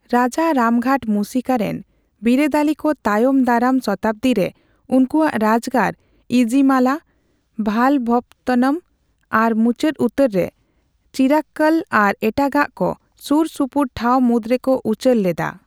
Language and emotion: Santali, neutral